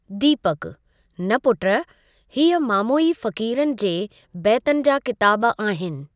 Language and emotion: Sindhi, neutral